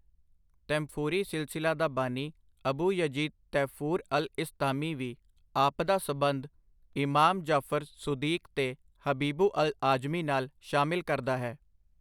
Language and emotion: Punjabi, neutral